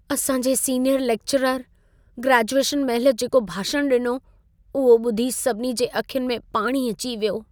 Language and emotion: Sindhi, sad